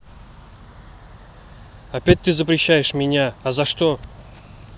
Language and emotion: Russian, angry